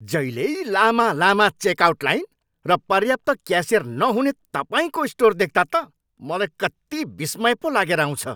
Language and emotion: Nepali, angry